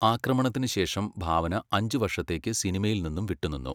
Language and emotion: Malayalam, neutral